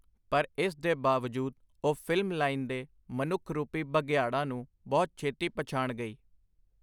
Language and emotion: Punjabi, neutral